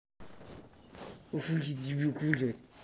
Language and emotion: Russian, angry